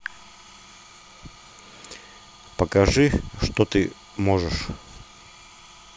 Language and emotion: Russian, neutral